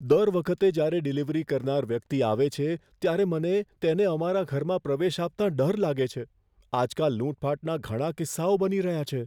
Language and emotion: Gujarati, fearful